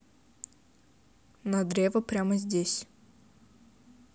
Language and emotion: Russian, neutral